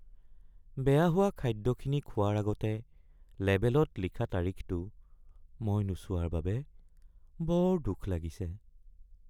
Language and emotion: Assamese, sad